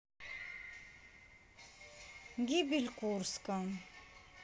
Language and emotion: Russian, neutral